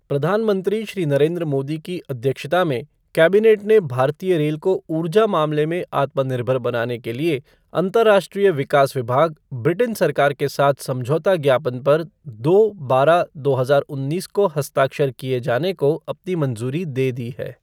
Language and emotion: Hindi, neutral